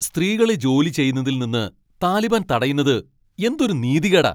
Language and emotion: Malayalam, angry